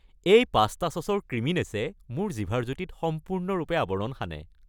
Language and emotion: Assamese, happy